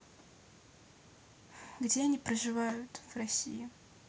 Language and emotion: Russian, neutral